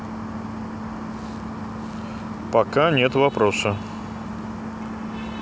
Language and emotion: Russian, neutral